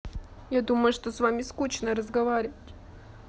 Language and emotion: Russian, sad